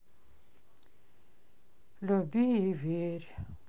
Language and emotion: Russian, sad